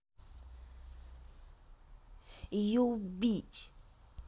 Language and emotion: Russian, angry